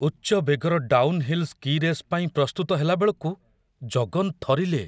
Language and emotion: Odia, fearful